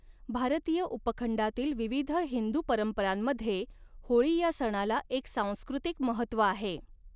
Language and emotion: Marathi, neutral